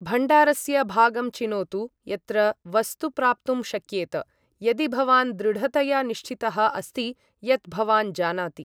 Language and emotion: Sanskrit, neutral